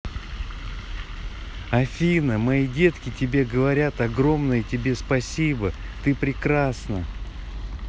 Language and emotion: Russian, positive